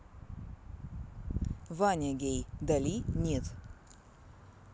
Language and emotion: Russian, neutral